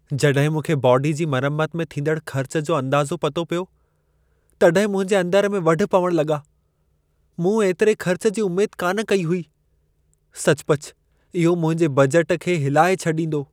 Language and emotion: Sindhi, sad